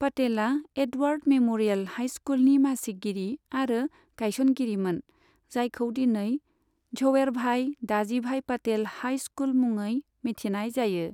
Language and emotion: Bodo, neutral